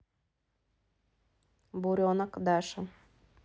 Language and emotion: Russian, neutral